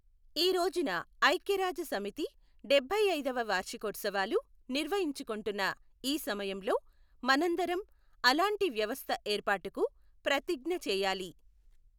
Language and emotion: Telugu, neutral